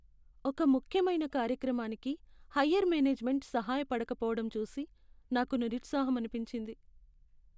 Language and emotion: Telugu, sad